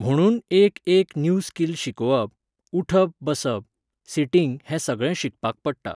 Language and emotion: Goan Konkani, neutral